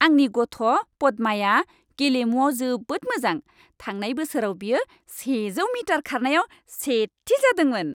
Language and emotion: Bodo, happy